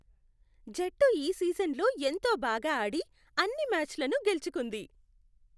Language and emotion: Telugu, happy